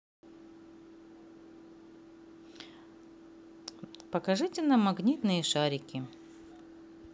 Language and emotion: Russian, positive